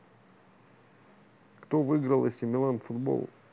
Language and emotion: Russian, neutral